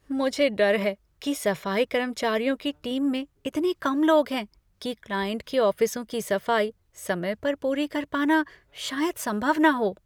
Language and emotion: Hindi, fearful